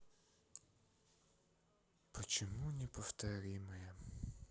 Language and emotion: Russian, sad